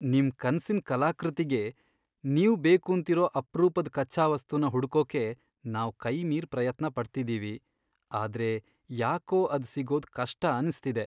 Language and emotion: Kannada, sad